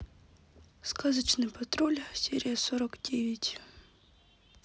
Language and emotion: Russian, sad